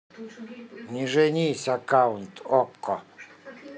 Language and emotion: Russian, neutral